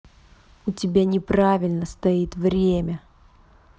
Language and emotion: Russian, angry